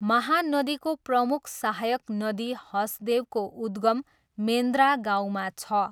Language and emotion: Nepali, neutral